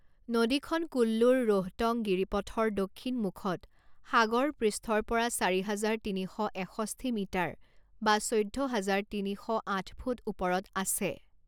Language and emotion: Assamese, neutral